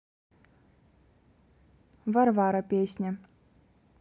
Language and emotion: Russian, neutral